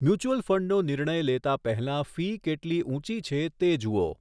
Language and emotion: Gujarati, neutral